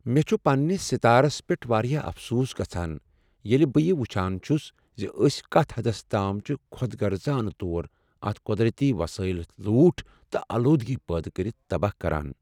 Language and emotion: Kashmiri, sad